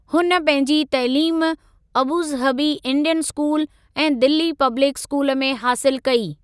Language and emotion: Sindhi, neutral